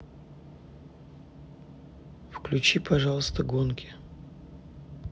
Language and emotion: Russian, neutral